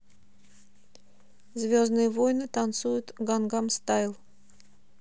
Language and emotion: Russian, neutral